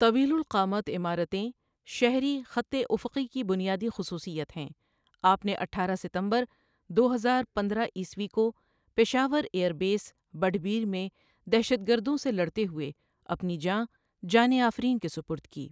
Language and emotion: Urdu, neutral